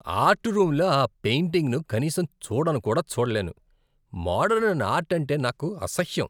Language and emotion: Telugu, disgusted